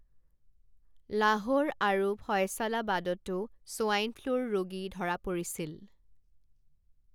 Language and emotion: Assamese, neutral